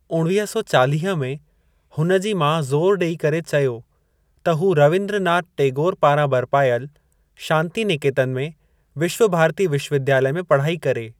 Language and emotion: Sindhi, neutral